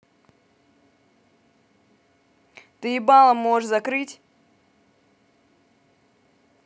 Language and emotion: Russian, angry